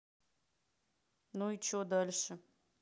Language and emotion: Russian, neutral